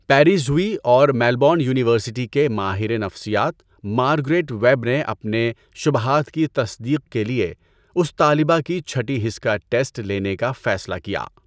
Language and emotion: Urdu, neutral